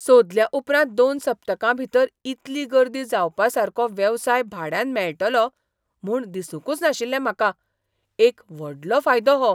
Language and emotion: Goan Konkani, surprised